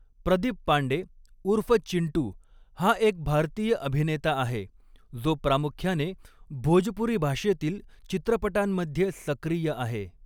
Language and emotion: Marathi, neutral